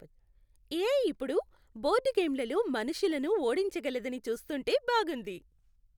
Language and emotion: Telugu, happy